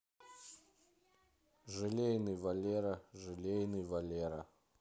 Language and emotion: Russian, neutral